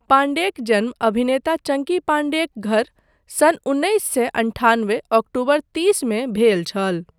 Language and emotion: Maithili, neutral